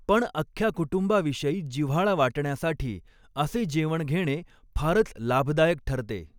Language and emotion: Marathi, neutral